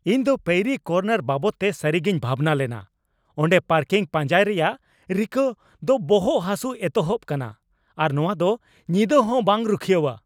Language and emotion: Santali, angry